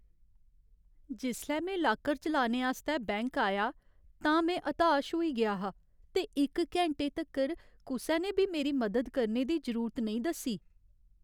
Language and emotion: Dogri, sad